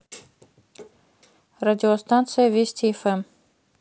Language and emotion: Russian, neutral